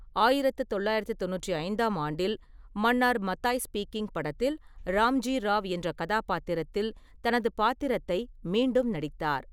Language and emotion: Tamil, neutral